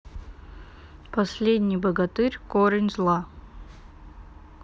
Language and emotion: Russian, neutral